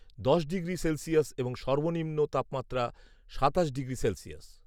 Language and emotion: Bengali, neutral